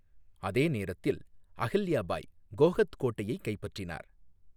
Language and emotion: Tamil, neutral